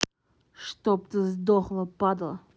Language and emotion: Russian, angry